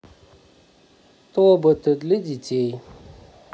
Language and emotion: Russian, neutral